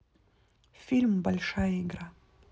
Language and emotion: Russian, neutral